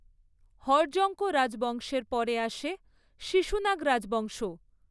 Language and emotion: Bengali, neutral